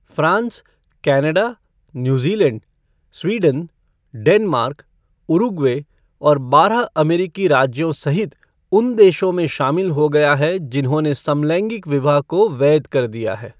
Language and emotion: Hindi, neutral